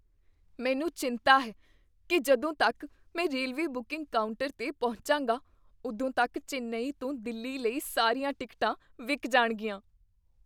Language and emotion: Punjabi, fearful